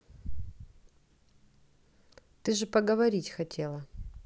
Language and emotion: Russian, neutral